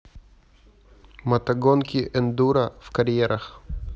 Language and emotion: Russian, neutral